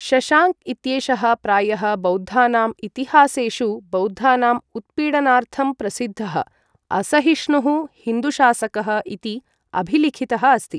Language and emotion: Sanskrit, neutral